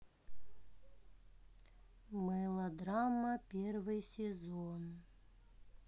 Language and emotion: Russian, sad